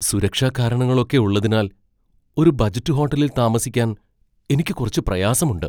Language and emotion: Malayalam, fearful